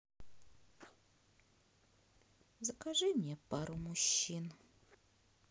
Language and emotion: Russian, sad